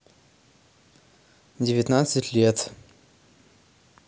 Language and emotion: Russian, neutral